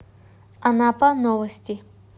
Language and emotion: Russian, neutral